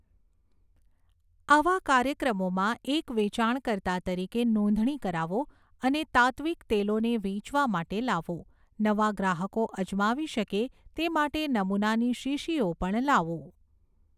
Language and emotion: Gujarati, neutral